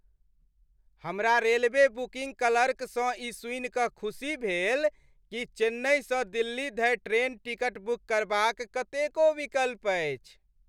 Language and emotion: Maithili, happy